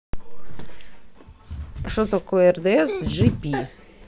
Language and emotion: Russian, neutral